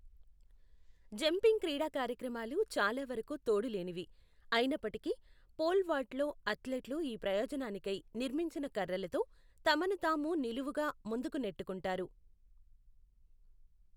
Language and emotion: Telugu, neutral